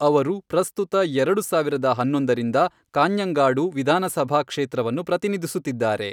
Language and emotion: Kannada, neutral